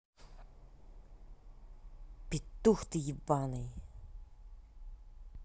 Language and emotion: Russian, angry